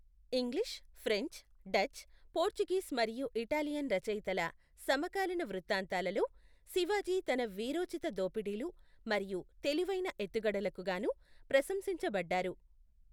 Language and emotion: Telugu, neutral